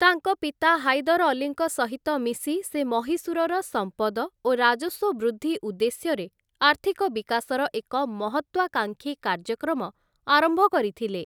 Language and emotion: Odia, neutral